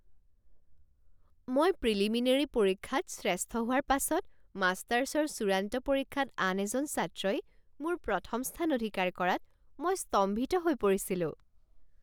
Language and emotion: Assamese, surprised